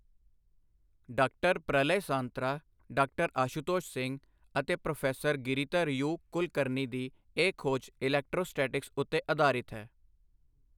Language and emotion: Punjabi, neutral